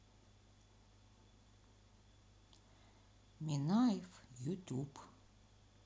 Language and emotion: Russian, sad